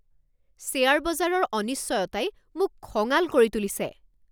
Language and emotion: Assamese, angry